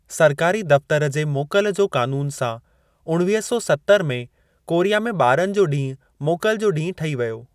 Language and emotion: Sindhi, neutral